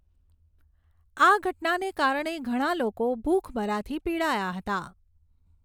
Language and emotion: Gujarati, neutral